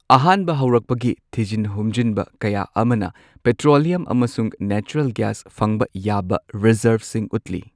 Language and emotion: Manipuri, neutral